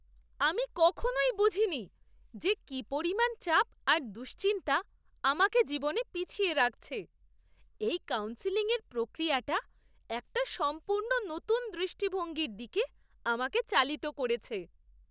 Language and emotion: Bengali, surprised